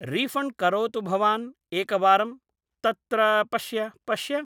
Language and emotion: Sanskrit, neutral